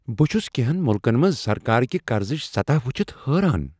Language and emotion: Kashmiri, surprised